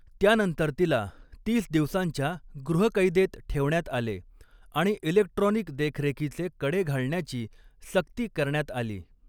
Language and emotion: Marathi, neutral